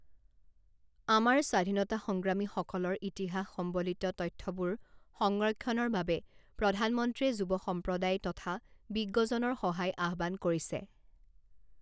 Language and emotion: Assamese, neutral